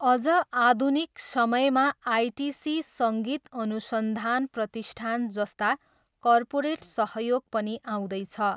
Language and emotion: Nepali, neutral